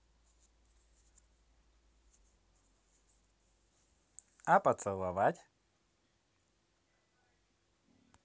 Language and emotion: Russian, positive